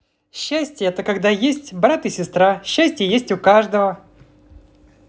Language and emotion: Russian, positive